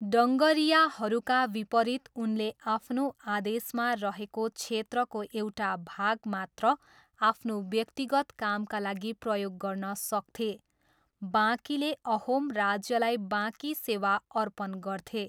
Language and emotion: Nepali, neutral